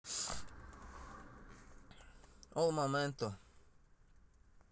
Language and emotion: Russian, neutral